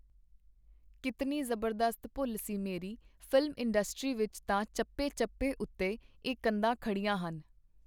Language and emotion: Punjabi, neutral